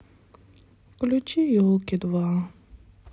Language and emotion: Russian, sad